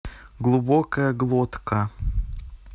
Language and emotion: Russian, neutral